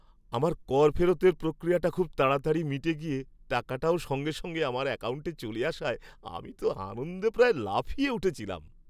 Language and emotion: Bengali, happy